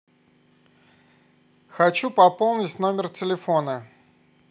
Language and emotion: Russian, neutral